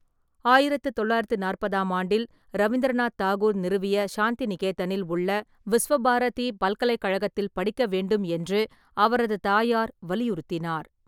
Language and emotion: Tamil, neutral